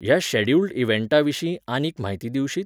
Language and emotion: Goan Konkani, neutral